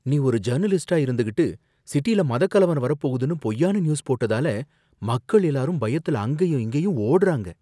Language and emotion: Tamil, fearful